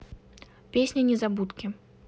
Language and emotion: Russian, neutral